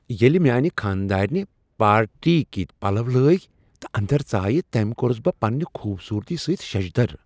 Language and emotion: Kashmiri, surprised